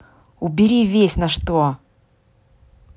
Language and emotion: Russian, angry